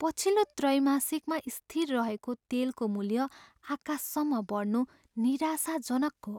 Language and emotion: Nepali, sad